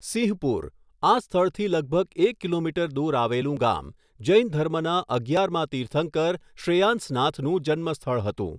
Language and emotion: Gujarati, neutral